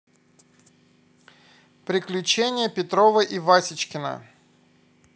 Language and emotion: Russian, neutral